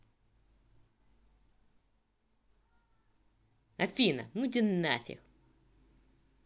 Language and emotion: Russian, angry